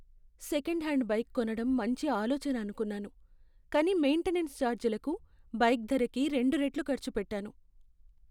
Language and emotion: Telugu, sad